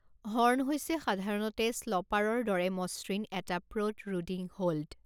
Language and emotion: Assamese, neutral